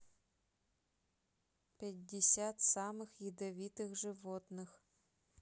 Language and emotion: Russian, neutral